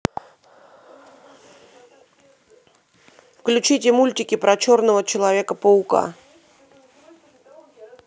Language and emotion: Russian, neutral